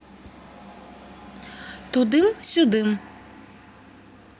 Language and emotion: Russian, neutral